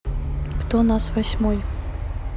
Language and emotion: Russian, neutral